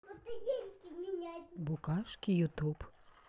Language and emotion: Russian, neutral